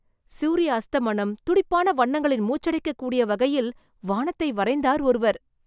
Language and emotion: Tamil, surprised